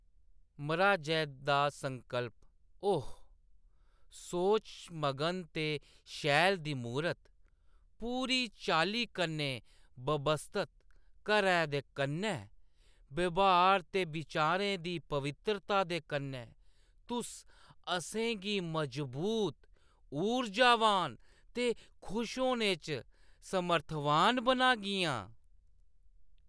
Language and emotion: Dogri, neutral